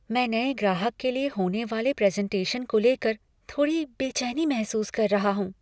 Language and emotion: Hindi, fearful